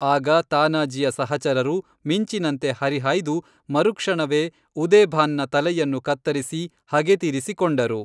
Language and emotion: Kannada, neutral